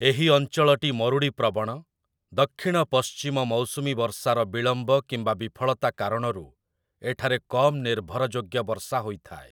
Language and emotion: Odia, neutral